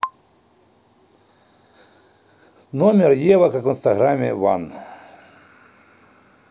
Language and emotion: Russian, neutral